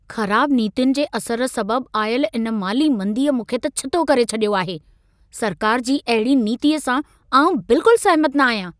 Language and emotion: Sindhi, angry